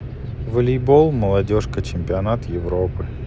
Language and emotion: Russian, sad